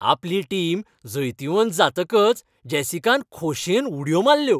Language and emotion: Goan Konkani, happy